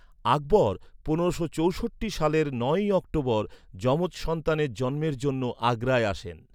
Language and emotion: Bengali, neutral